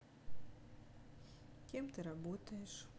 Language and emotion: Russian, neutral